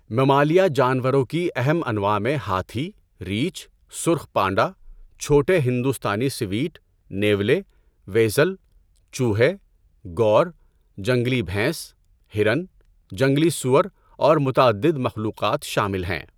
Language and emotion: Urdu, neutral